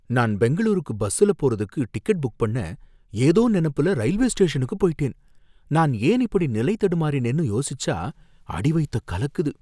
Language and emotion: Tamil, fearful